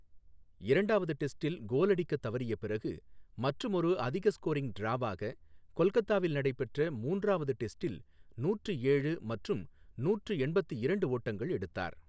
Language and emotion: Tamil, neutral